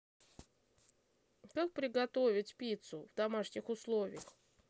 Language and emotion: Russian, neutral